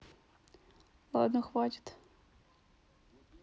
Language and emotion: Russian, neutral